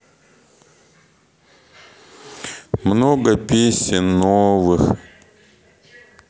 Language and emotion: Russian, sad